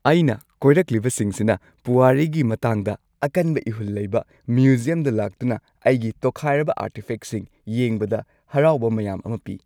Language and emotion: Manipuri, happy